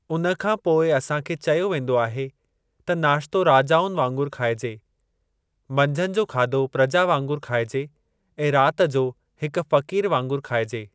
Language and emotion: Sindhi, neutral